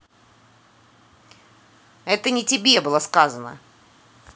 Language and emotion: Russian, angry